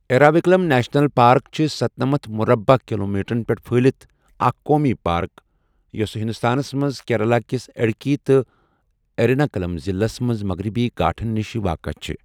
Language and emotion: Kashmiri, neutral